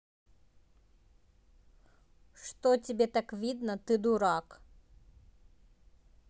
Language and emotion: Russian, neutral